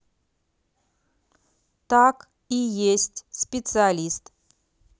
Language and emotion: Russian, neutral